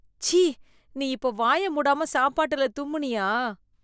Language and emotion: Tamil, disgusted